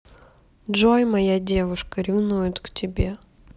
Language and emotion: Russian, neutral